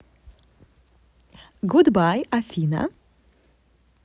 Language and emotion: Russian, positive